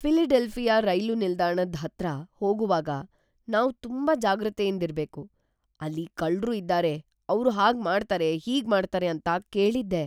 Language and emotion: Kannada, fearful